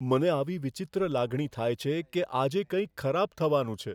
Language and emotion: Gujarati, fearful